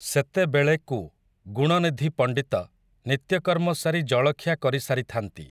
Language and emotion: Odia, neutral